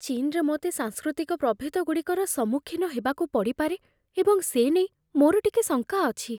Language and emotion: Odia, fearful